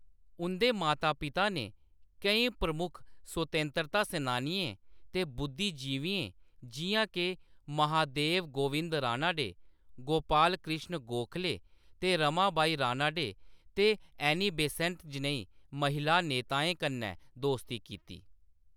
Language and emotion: Dogri, neutral